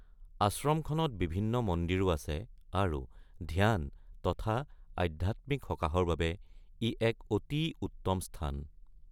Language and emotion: Assamese, neutral